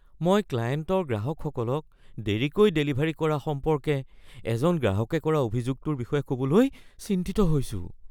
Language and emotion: Assamese, fearful